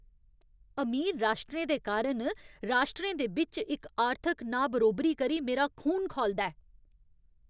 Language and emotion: Dogri, angry